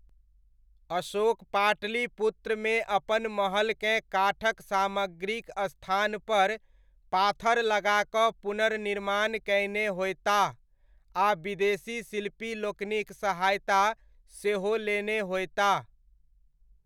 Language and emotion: Maithili, neutral